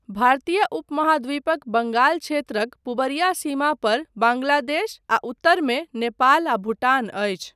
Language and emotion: Maithili, neutral